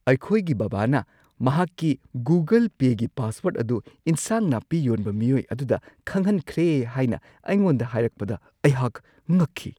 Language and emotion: Manipuri, surprised